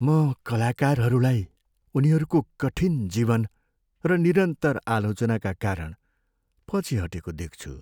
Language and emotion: Nepali, sad